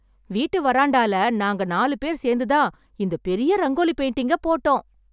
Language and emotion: Tamil, happy